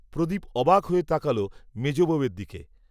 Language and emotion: Bengali, neutral